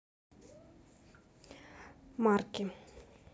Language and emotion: Russian, neutral